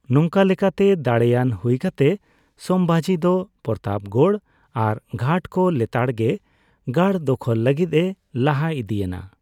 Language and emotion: Santali, neutral